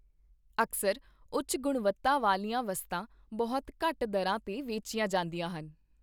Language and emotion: Punjabi, neutral